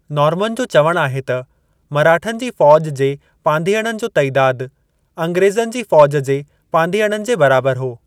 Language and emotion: Sindhi, neutral